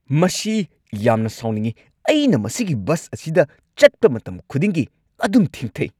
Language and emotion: Manipuri, angry